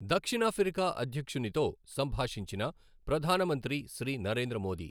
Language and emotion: Telugu, neutral